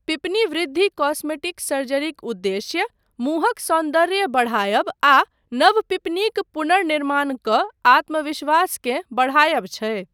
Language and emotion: Maithili, neutral